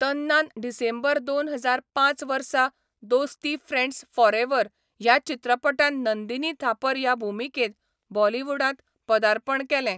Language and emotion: Goan Konkani, neutral